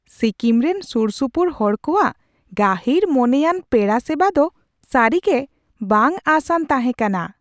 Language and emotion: Santali, surprised